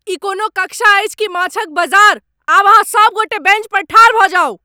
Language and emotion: Maithili, angry